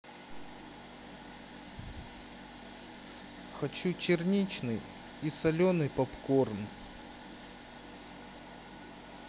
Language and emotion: Russian, sad